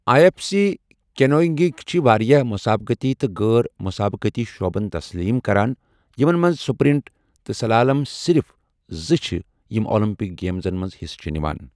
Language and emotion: Kashmiri, neutral